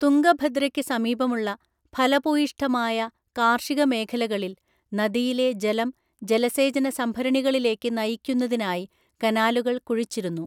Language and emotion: Malayalam, neutral